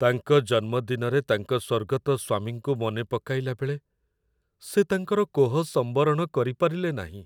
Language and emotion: Odia, sad